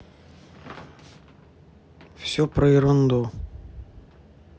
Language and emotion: Russian, neutral